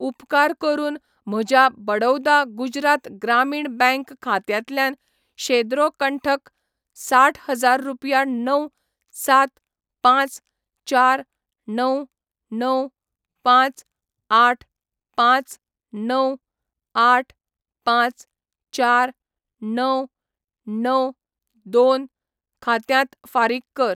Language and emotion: Goan Konkani, neutral